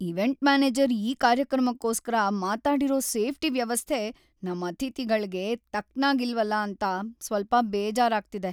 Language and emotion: Kannada, sad